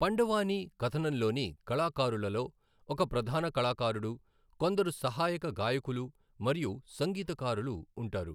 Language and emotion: Telugu, neutral